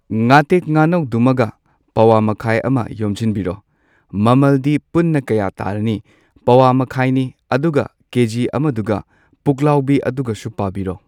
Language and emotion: Manipuri, neutral